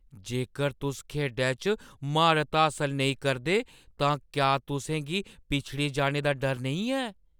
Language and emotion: Dogri, fearful